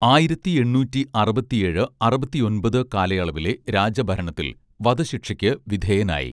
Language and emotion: Malayalam, neutral